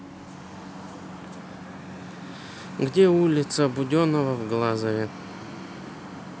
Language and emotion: Russian, neutral